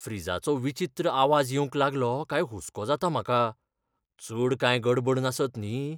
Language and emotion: Goan Konkani, fearful